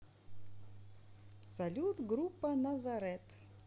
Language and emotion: Russian, positive